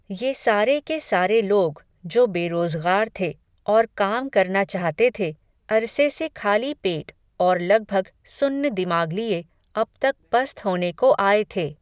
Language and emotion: Hindi, neutral